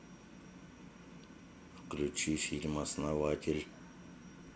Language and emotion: Russian, neutral